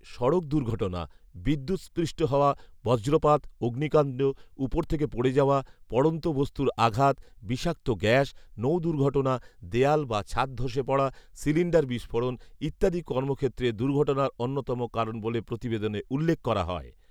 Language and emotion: Bengali, neutral